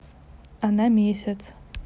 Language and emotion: Russian, neutral